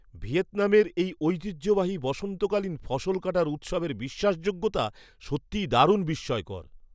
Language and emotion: Bengali, surprised